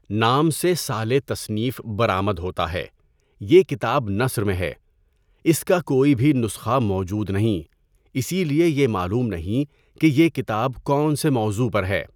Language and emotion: Urdu, neutral